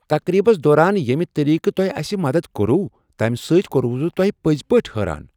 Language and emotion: Kashmiri, surprised